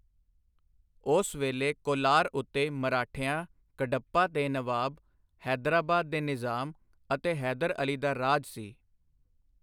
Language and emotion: Punjabi, neutral